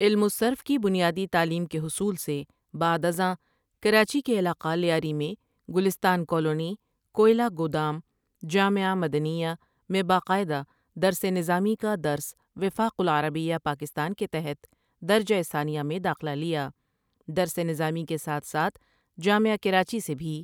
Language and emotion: Urdu, neutral